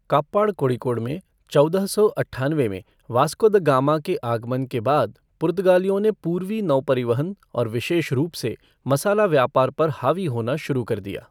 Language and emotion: Hindi, neutral